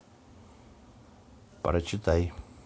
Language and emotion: Russian, neutral